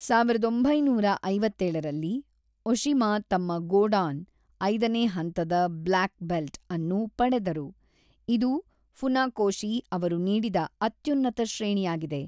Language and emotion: Kannada, neutral